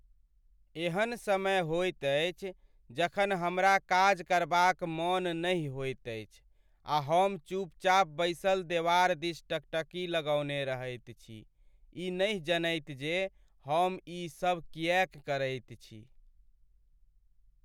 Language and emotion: Maithili, sad